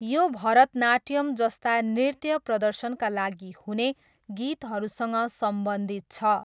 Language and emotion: Nepali, neutral